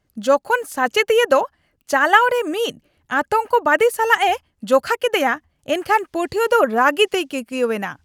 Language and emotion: Santali, angry